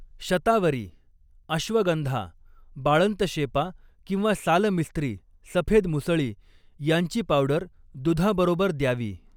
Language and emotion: Marathi, neutral